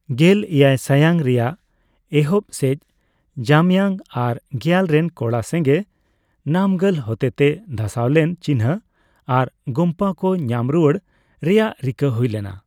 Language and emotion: Santali, neutral